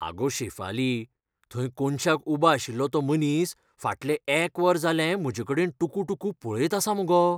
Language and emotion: Goan Konkani, fearful